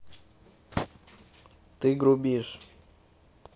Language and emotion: Russian, neutral